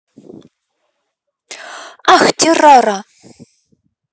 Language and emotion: Russian, neutral